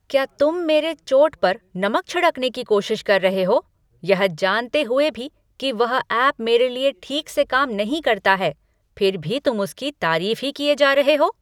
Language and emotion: Hindi, angry